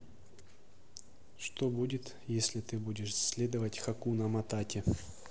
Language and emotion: Russian, neutral